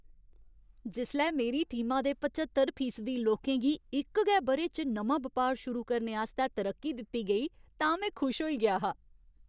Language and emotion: Dogri, happy